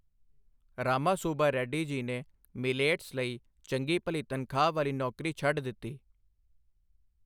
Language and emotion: Punjabi, neutral